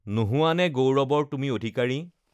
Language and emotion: Assamese, neutral